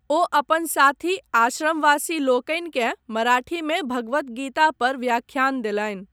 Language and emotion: Maithili, neutral